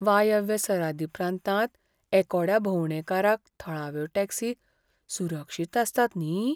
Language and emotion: Goan Konkani, fearful